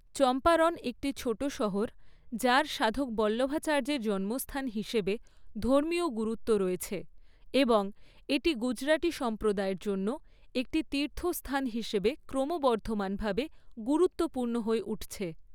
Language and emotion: Bengali, neutral